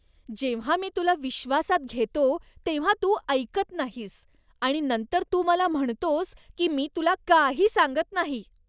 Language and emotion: Marathi, disgusted